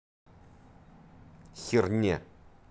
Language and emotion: Russian, angry